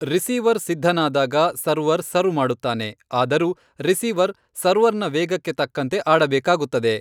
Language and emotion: Kannada, neutral